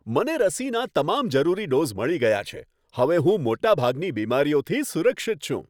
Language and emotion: Gujarati, happy